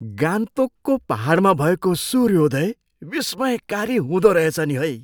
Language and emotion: Nepali, surprised